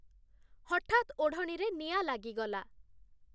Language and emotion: Odia, neutral